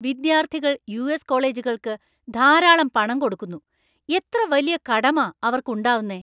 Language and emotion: Malayalam, angry